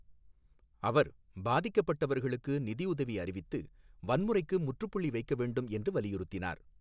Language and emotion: Tamil, neutral